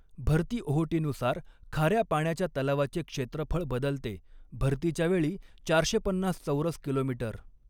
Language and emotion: Marathi, neutral